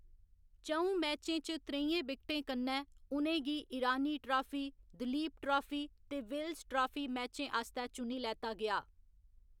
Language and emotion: Dogri, neutral